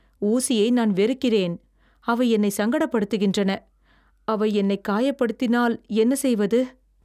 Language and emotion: Tamil, fearful